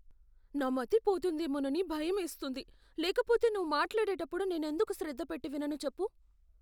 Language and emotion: Telugu, fearful